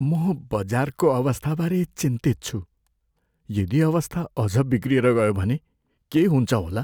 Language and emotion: Nepali, fearful